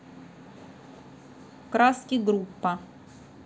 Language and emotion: Russian, neutral